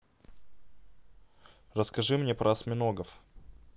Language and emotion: Russian, neutral